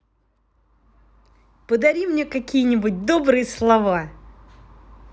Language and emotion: Russian, positive